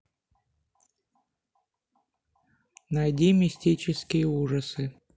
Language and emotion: Russian, neutral